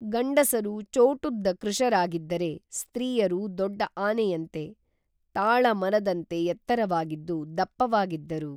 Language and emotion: Kannada, neutral